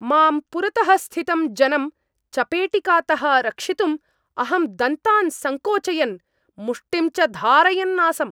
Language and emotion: Sanskrit, angry